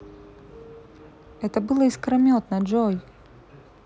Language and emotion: Russian, neutral